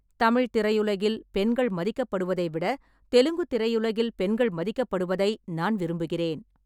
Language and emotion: Tamil, neutral